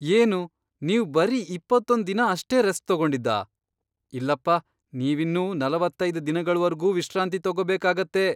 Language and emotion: Kannada, surprised